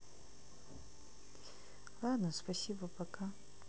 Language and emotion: Russian, sad